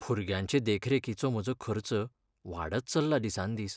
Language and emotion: Goan Konkani, sad